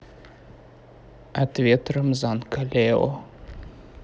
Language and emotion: Russian, neutral